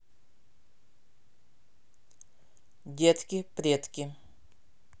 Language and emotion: Russian, neutral